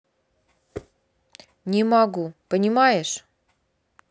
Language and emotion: Russian, neutral